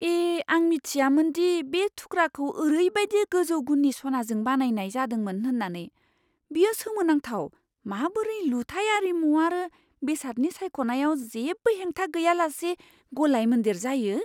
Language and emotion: Bodo, surprised